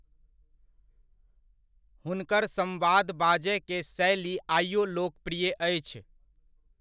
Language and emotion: Maithili, neutral